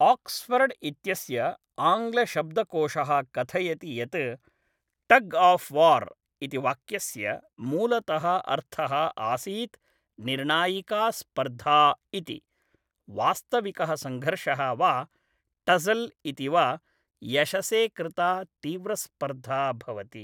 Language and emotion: Sanskrit, neutral